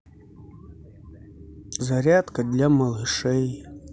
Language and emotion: Russian, sad